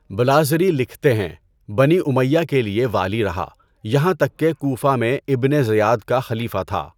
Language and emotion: Urdu, neutral